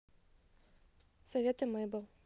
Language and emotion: Russian, neutral